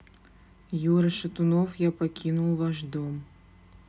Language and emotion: Russian, neutral